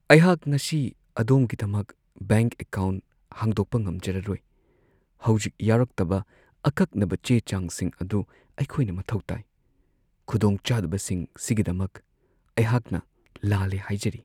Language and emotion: Manipuri, sad